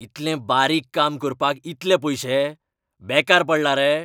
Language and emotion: Goan Konkani, angry